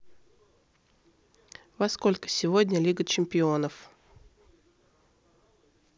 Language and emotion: Russian, neutral